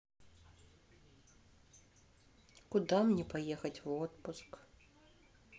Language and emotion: Russian, sad